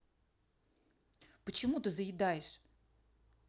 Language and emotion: Russian, angry